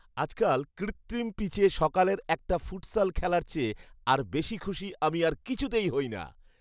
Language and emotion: Bengali, happy